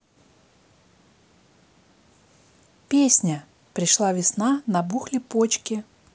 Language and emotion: Russian, neutral